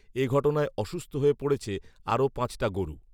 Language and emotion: Bengali, neutral